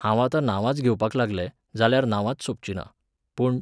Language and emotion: Goan Konkani, neutral